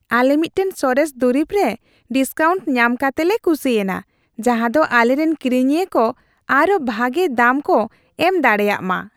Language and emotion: Santali, happy